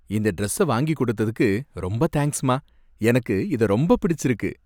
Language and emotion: Tamil, happy